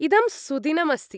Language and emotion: Sanskrit, happy